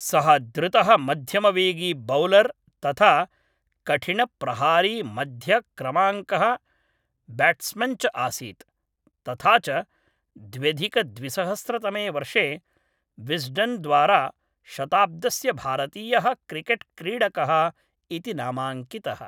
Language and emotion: Sanskrit, neutral